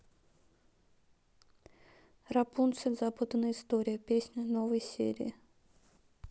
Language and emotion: Russian, neutral